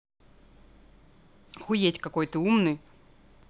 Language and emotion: Russian, angry